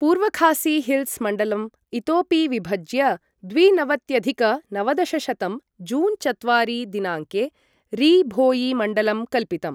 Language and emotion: Sanskrit, neutral